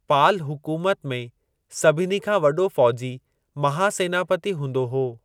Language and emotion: Sindhi, neutral